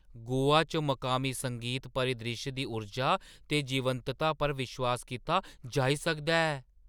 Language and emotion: Dogri, surprised